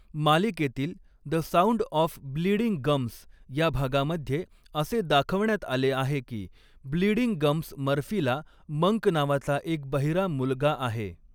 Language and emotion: Marathi, neutral